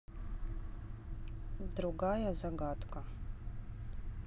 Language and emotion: Russian, neutral